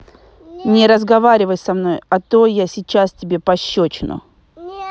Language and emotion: Russian, angry